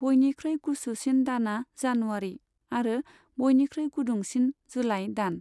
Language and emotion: Bodo, neutral